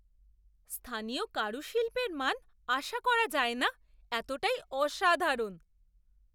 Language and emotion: Bengali, surprised